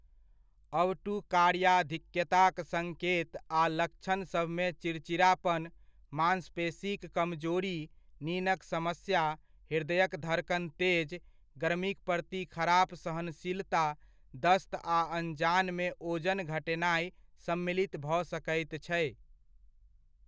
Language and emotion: Maithili, neutral